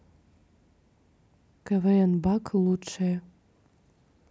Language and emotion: Russian, neutral